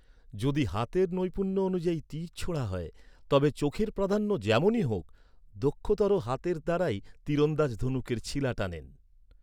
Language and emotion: Bengali, neutral